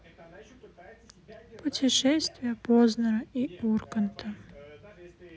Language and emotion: Russian, sad